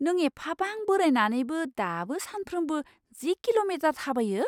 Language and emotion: Bodo, surprised